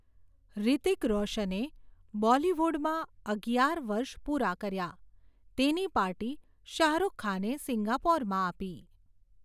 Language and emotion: Gujarati, neutral